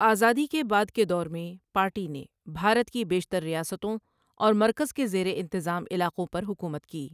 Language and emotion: Urdu, neutral